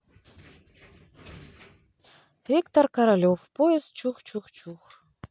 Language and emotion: Russian, neutral